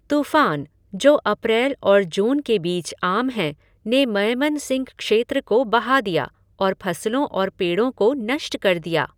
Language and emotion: Hindi, neutral